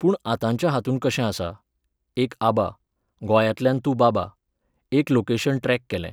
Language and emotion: Goan Konkani, neutral